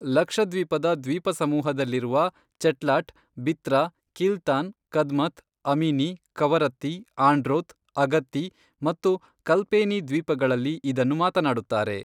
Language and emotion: Kannada, neutral